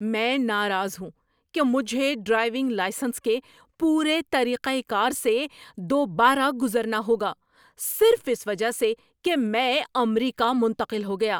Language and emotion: Urdu, angry